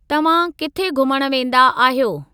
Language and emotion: Sindhi, neutral